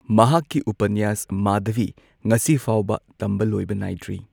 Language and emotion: Manipuri, neutral